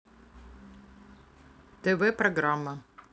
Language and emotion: Russian, neutral